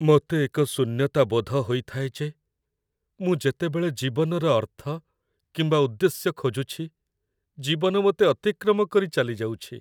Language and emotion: Odia, sad